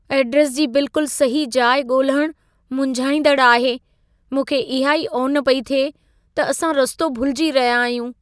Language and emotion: Sindhi, fearful